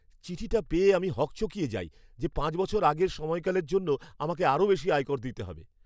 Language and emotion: Bengali, fearful